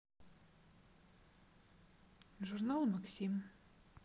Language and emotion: Russian, neutral